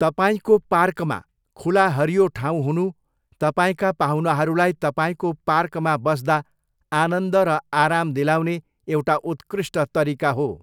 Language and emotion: Nepali, neutral